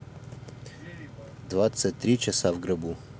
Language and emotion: Russian, neutral